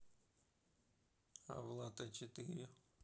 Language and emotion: Russian, neutral